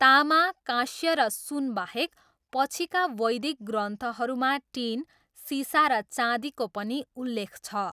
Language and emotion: Nepali, neutral